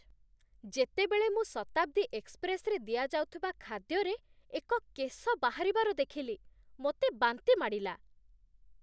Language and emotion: Odia, disgusted